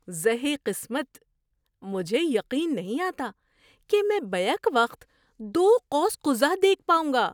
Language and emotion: Urdu, surprised